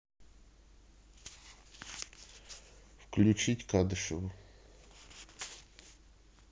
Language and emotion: Russian, neutral